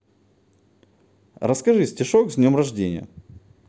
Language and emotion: Russian, positive